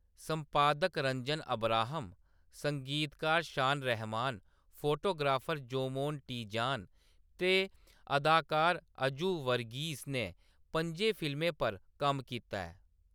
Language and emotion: Dogri, neutral